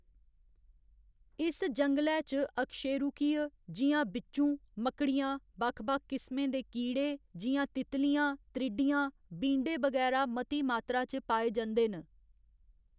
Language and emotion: Dogri, neutral